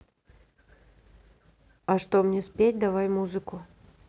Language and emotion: Russian, neutral